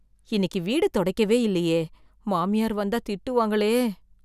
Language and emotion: Tamil, fearful